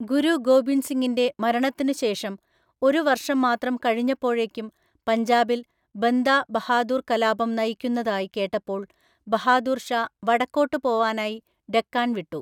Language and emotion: Malayalam, neutral